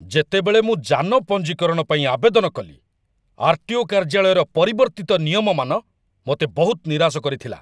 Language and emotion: Odia, angry